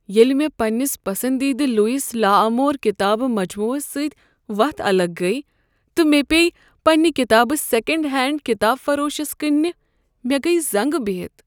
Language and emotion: Kashmiri, sad